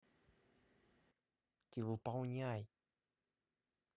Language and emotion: Russian, angry